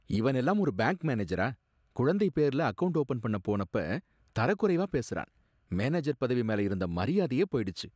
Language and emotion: Tamil, disgusted